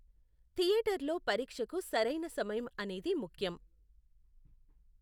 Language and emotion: Telugu, neutral